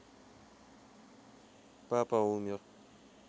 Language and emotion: Russian, sad